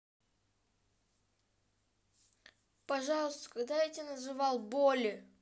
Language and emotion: Russian, sad